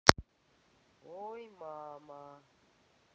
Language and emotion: Russian, neutral